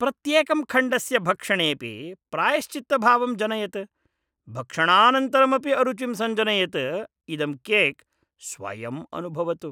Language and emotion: Sanskrit, disgusted